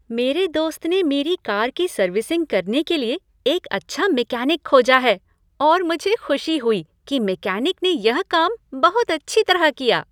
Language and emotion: Hindi, happy